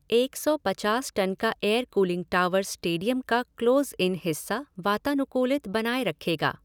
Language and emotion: Hindi, neutral